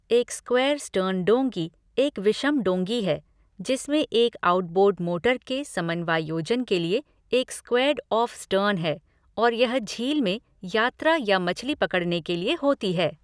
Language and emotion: Hindi, neutral